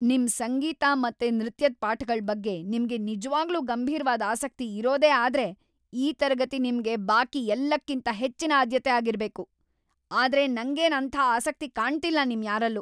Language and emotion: Kannada, angry